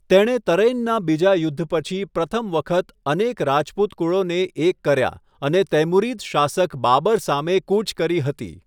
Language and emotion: Gujarati, neutral